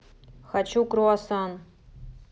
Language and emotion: Russian, neutral